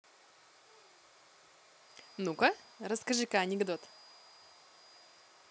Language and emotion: Russian, positive